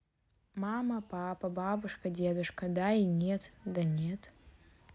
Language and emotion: Russian, neutral